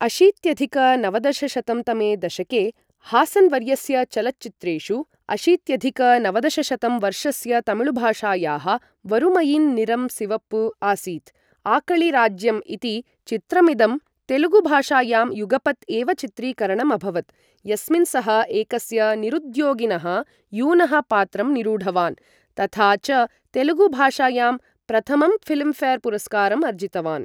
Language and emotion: Sanskrit, neutral